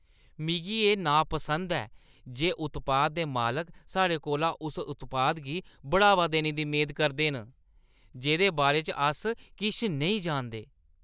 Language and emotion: Dogri, disgusted